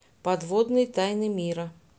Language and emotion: Russian, neutral